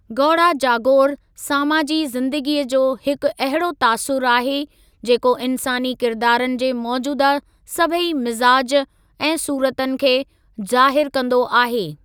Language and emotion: Sindhi, neutral